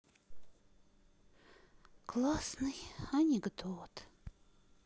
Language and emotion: Russian, sad